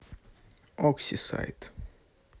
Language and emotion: Russian, neutral